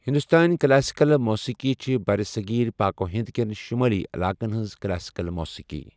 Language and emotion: Kashmiri, neutral